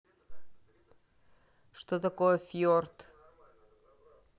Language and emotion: Russian, neutral